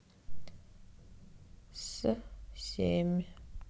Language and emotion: Russian, sad